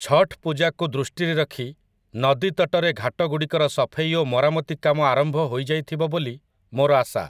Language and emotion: Odia, neutral